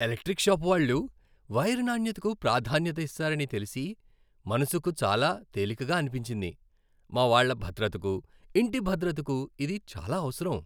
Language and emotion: Telugu, happy